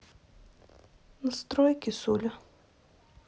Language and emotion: Russian, sad